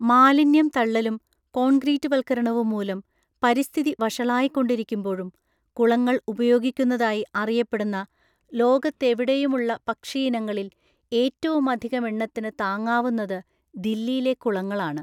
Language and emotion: Malayalam, neutral